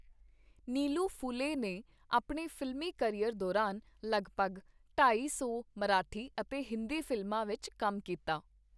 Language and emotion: Punjabi, neutral